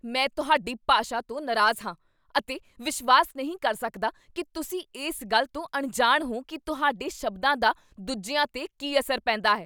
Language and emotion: Punjabi, angry